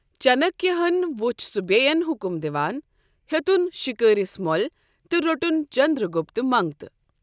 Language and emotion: Kashmiri, neutral